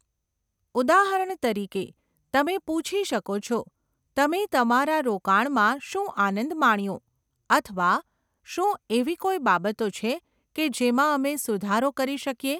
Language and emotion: Gujarati, neutral